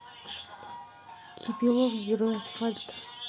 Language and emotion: Russian, neutral